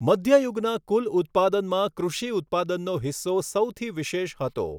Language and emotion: Gujarati, neutral